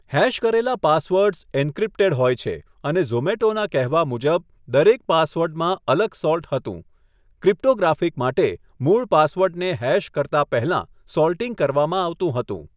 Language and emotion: Gujarati, neutral